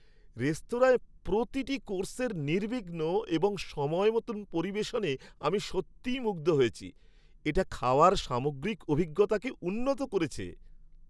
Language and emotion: Bengali, happy